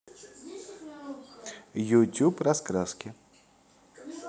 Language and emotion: Russian, positive